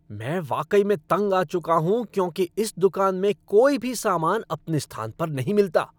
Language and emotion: Hindi, angry